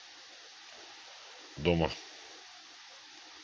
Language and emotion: Russian, neutral